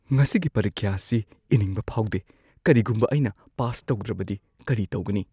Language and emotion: Manipuri, fearful